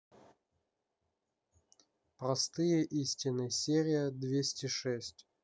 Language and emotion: Russian, neutral